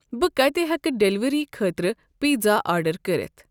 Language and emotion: Kashmiri, neutral